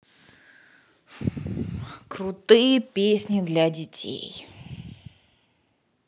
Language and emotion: Russian, angry